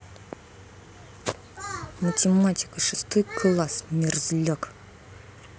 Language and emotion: Russian, angry